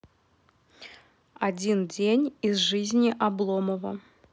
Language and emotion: Russian, neutral